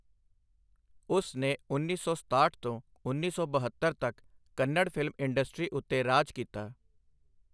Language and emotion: Punjabi, neutral